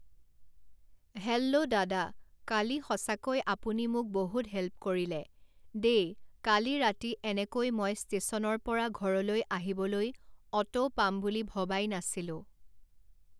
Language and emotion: Assamese, neutral